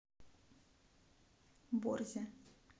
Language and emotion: Russian, neutral